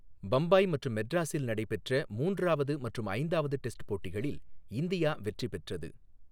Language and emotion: Tamil, neutral